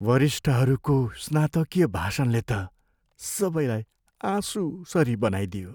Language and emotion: Nepali, sad